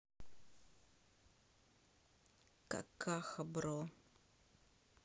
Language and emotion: Russian, neutral